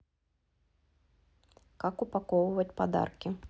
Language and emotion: Russian, neutral